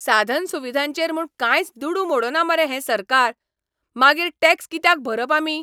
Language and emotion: Goan Konkani, angry